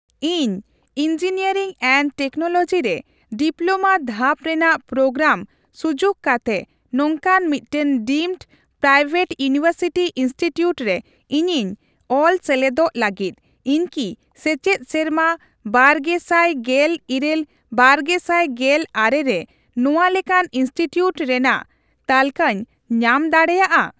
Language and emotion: Santali, neutral